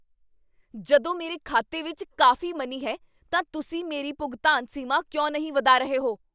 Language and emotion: Punjabi, angry